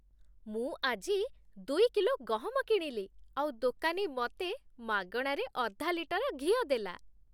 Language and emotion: Odia, happy